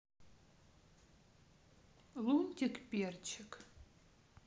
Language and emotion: Russian, neutral